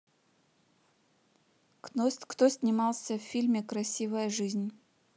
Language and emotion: Russian, neutral